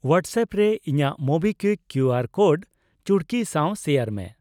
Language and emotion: Santali, neutral